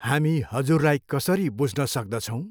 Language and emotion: Nepali, neutral